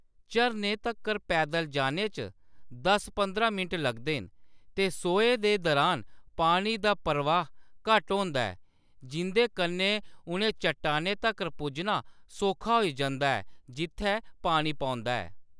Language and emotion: Dogri, neutral